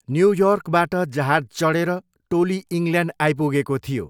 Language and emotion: Nepali, neutral